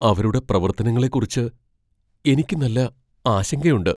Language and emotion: Malayalam, fearful